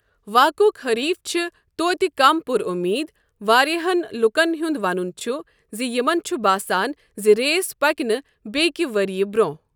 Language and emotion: Kashmiri, neutral